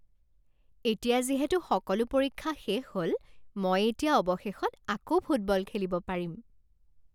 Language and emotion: Assamese, happy